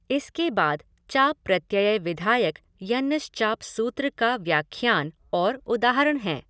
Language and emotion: Hindi, neutral